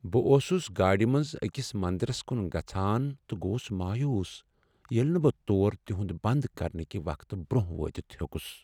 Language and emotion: Kashmiri, sad